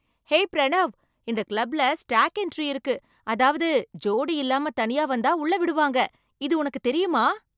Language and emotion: Tamil, surprised